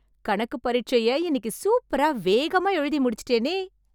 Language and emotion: Tamil, happy